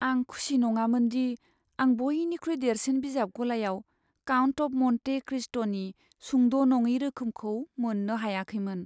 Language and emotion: Bodo, sad